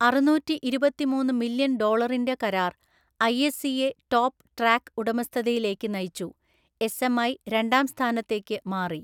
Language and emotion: Malayalam, neutral